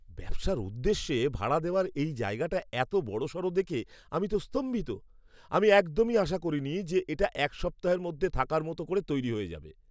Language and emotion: Bengali, surprised